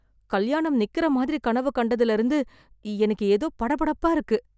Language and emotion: Tamil, fearful